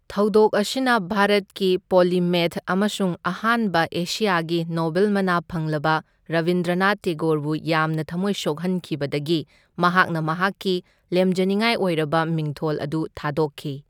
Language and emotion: Manipuri, neutral